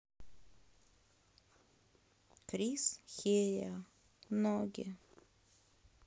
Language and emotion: Russian, sad